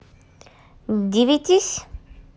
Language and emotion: Russian, neutral